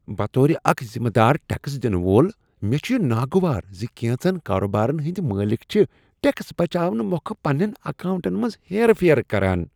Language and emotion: Kashmiri, disgusted